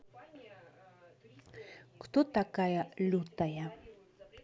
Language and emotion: Russian, neutral